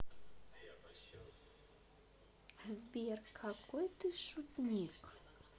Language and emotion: Russian, positive